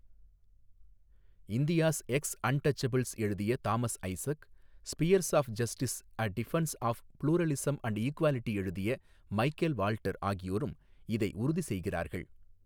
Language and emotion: Tamil, neutral